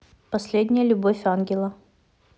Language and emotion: Russian, neutral